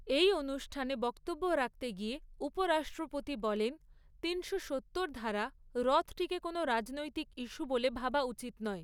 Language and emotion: Bengali, neutral